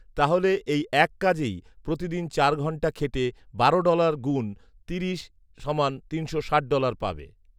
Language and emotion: Bengali, neutral